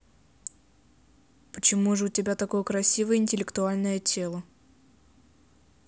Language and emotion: Russian, neutral